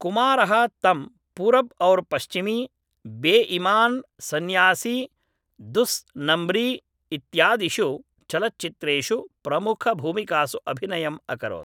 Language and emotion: Sanskrit, neutral